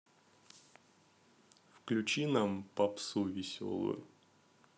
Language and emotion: Russian, neutral